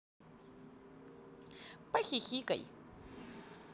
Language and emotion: Russian, positive